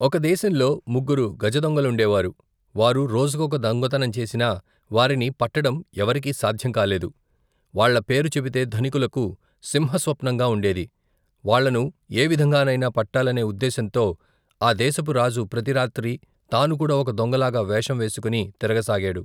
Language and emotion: Telugu, neutral